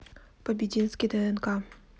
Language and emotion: Russian, neutral